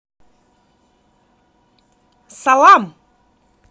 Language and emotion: Russian, positive